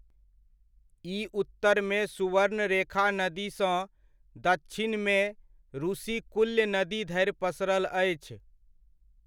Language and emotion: Maithili, neutral